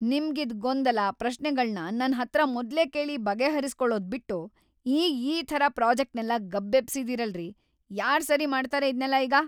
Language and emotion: Kannada, angry